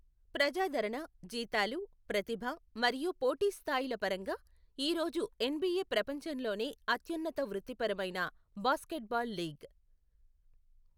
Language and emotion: Telugu, neutral